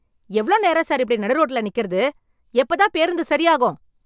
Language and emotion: Tamil, angry